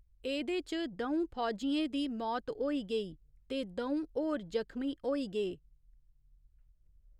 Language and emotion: Dogri, neutral